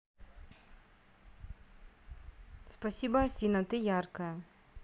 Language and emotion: Russian, neutral